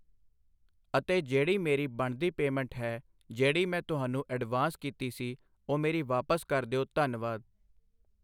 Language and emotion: Punjabi, neutral